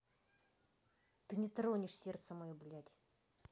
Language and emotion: Russian, angry